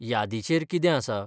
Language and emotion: Goan Konkani, neutral